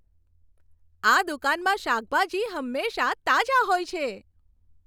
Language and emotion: Gujarati, happy